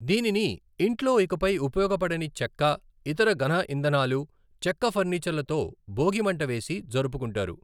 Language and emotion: Telugu, neutral